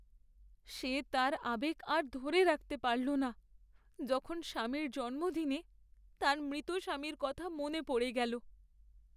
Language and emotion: Bengali, sad